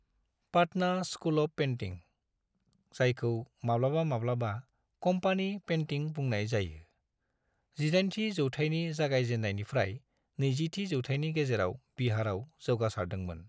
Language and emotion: Bodo, neutral